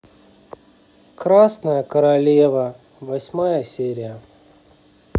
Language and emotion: Russian, sad